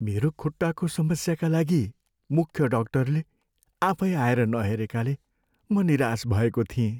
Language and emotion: Nepali, sad